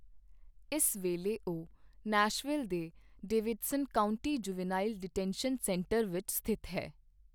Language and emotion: Punjabi, neutral